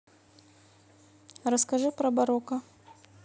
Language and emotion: Russian, neutral